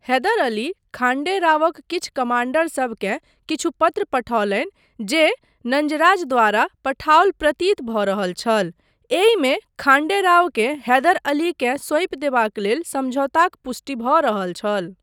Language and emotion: Maithili, neutral